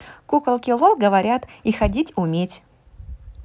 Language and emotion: Russian, positive